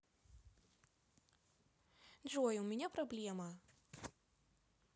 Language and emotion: Russian, sad